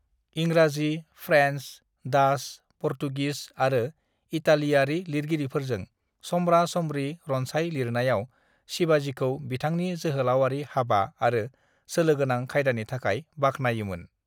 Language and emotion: Bodo, neutral